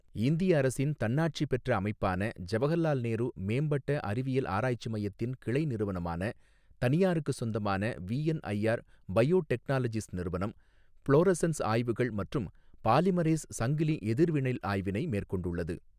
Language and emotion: Tamil, neutral